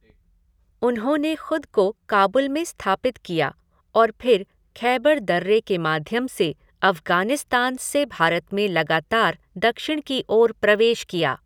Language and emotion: Hindi, neutral